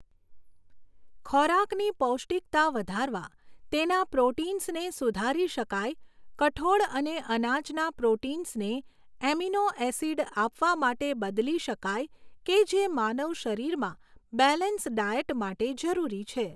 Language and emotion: Gujarati, neutral